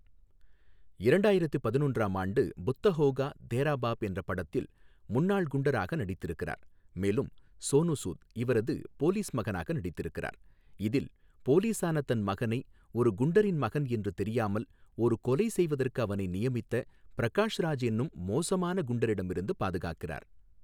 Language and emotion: Tamil, neutral